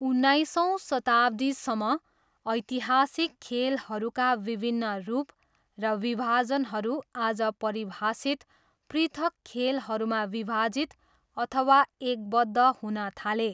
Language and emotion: Nepali, neutral